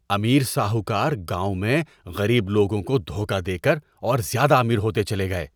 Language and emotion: Urdu, disgusted